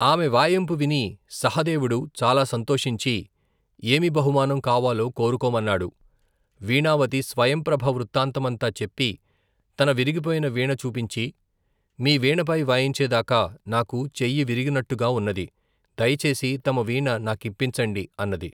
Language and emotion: Telugu, neutral